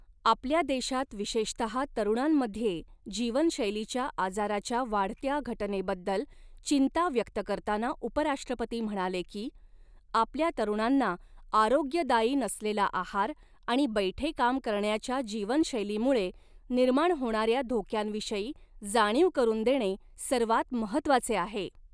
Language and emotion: Marathi, neutral